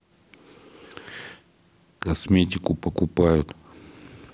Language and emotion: Russian, neutral